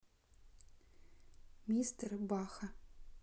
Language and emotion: Russian, neutral